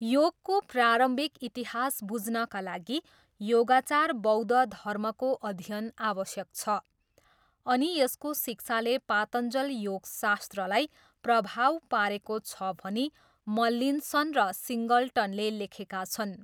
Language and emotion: Nepali, neutral